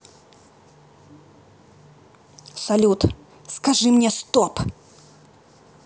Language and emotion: Russian, angry